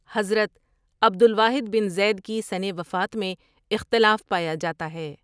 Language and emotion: Urdu, neutral